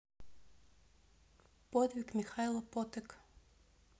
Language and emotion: Russian, neutral